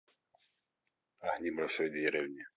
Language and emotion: Russian, neutral